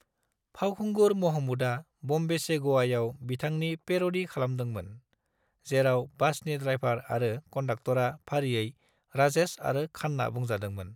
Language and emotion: Bodo, neutral